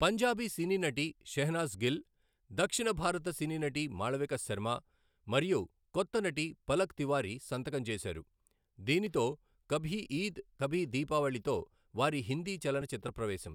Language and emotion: Telugu, neutral